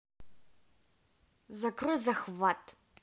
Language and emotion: Russian, angry